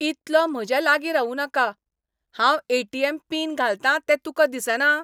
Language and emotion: Goan Konkani, angry